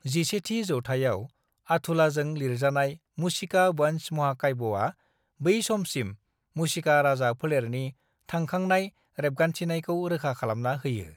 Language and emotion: Bodo, neutral